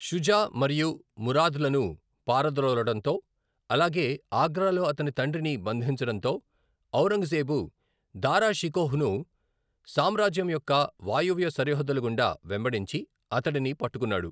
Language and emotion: Telugu, neutral